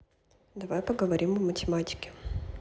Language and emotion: Russian, neutral